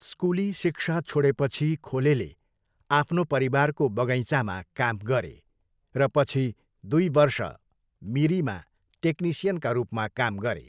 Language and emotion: Nepali, neutral